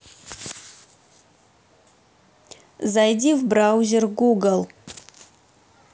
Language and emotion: Russian, neutral